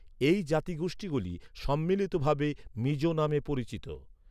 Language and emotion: Bengali, neutral